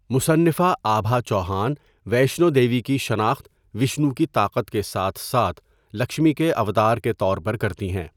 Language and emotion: Urdu, neutral